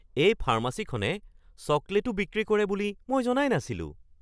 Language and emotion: Assamese, surprised